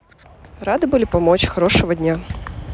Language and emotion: Russian, neutral